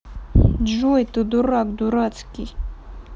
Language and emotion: Russian, angry